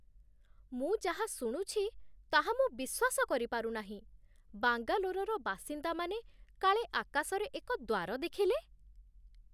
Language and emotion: Odia, surprised